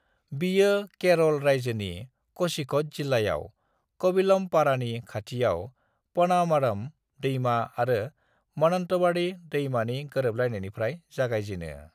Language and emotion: Bodo, neutral